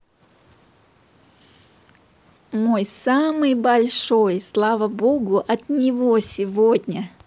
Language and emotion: Russian, positive